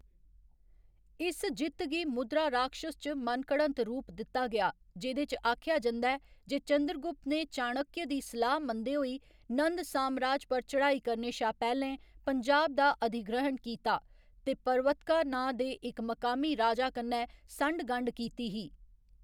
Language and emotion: Dogri, neutral